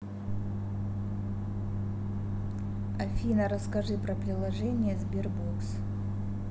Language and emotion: Russian, neutral